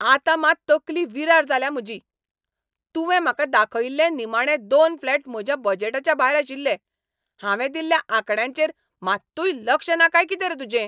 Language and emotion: Goan Konkani, angry